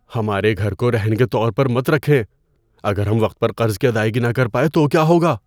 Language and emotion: Urdu, fearful